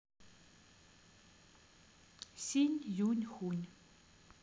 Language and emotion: Russian, neutral